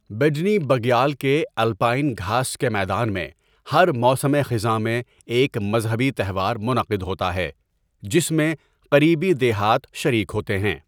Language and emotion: Urdu, neutral